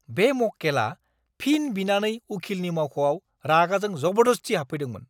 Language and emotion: Bodo, angry